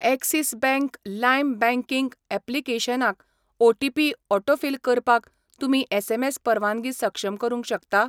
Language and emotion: Goan Konkani, neutral